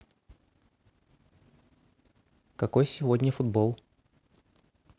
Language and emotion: Russian, neutral